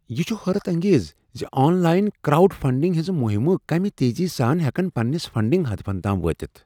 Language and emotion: Kashmiri, surprised